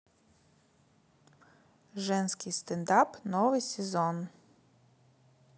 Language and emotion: Russian, neutral